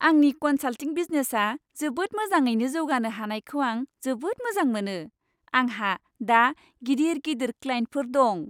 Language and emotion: Bodo, happy